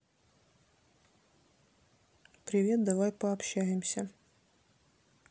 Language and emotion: Russian, neutral